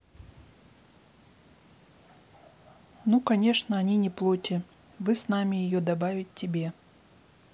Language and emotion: Russian, neutral